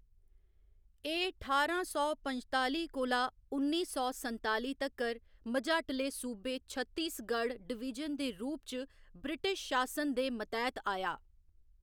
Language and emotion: Dogri, neutral